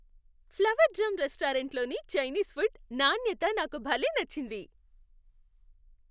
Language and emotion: Telugu, happy